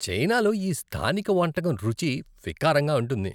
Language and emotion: Telugu, disgusted